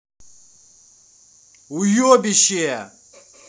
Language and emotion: Russian, angry